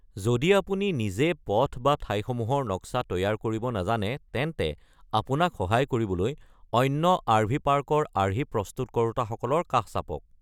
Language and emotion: Assamese, neutral